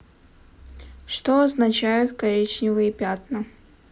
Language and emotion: Russian, neutral